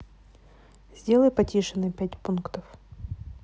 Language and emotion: Russian, neutral